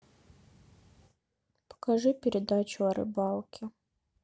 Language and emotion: Russian, sad